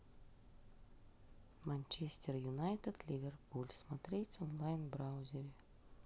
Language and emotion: Russian, neutral